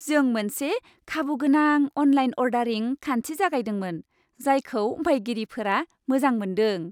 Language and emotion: Bodo, happy